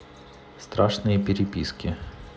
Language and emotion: Russian, neutral